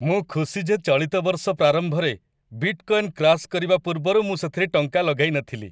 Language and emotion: Odia, happy